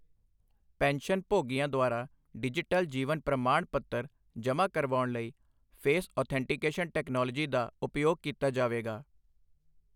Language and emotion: Punjabi, neutral